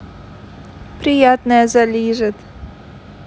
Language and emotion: Russian, neutral